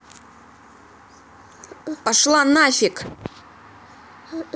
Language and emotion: Russian, angry